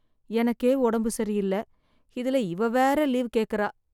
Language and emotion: Tamil, sad